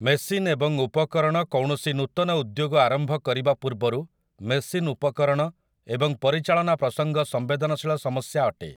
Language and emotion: Odia, neutral